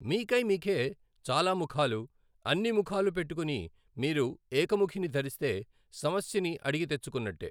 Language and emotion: Telugu, neutral